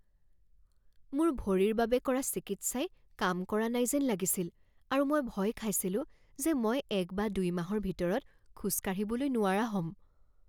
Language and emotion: Assamese, fearful